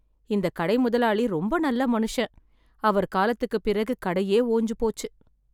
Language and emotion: Tamil, sad